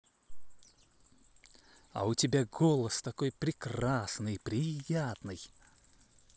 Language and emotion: Russian, positive